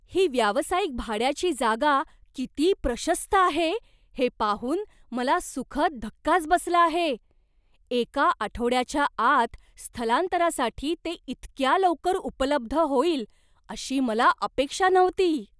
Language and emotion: Marathi, surprised